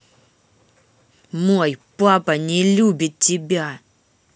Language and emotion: Russian, angry